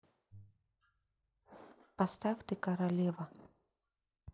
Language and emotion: Russian, neutral